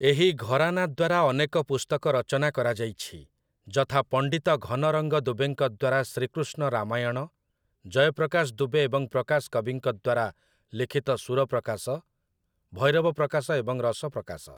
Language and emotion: Odia, neutral